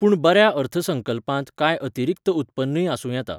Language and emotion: Goan Konkani, neutral